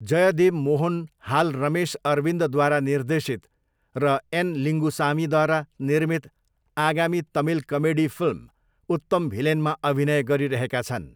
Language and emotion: Nepali, neutral